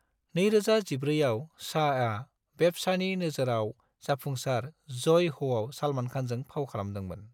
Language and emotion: Bodo, neutral